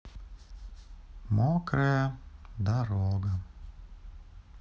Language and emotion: Russian, sad